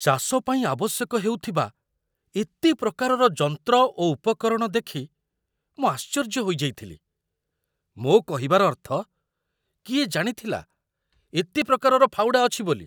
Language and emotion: Odia, surprised